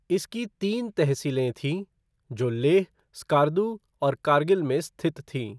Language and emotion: Hindi, neutral